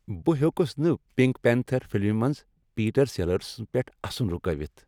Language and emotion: Kashmiri, happy